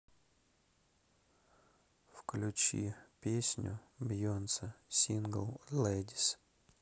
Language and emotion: Russian, neutral